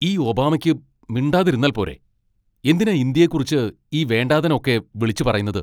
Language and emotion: Malayalam, angry